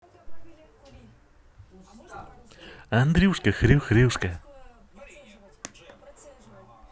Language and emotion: Russian, positive